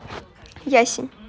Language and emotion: Russian, neutral